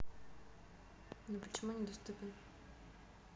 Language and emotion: Russian, neutral